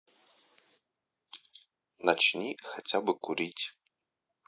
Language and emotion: Russian, neutral